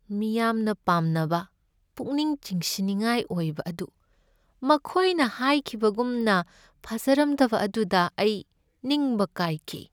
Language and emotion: Manipuri, sad